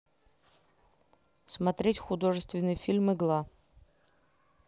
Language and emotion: Russian, neutral